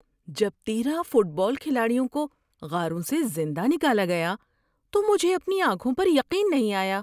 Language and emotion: Urdu, surprised